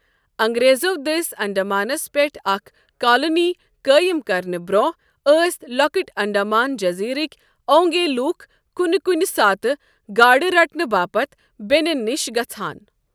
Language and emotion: Kashmiri, neutral